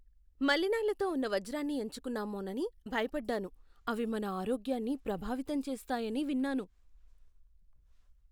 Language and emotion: Telugu, fearful